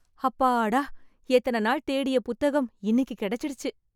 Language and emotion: Tamil, happy